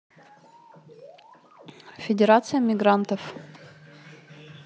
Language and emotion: Russian, neutral